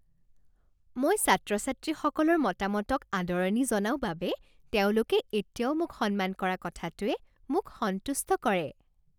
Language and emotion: Assamese, happy